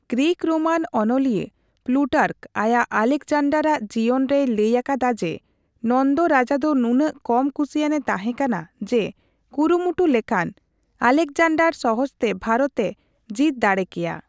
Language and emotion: Santali, neutral